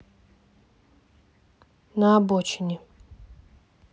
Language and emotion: Russian, neutral